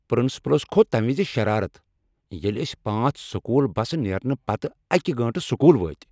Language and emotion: Kashmiri, angry